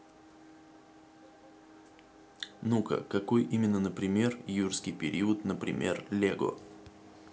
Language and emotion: Russian, neutral